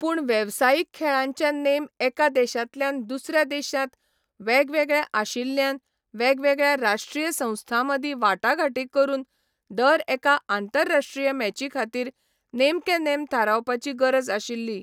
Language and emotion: Goan Konkani, neutral